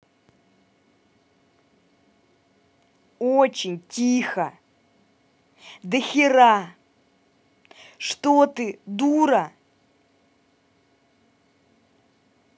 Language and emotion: Russian, angry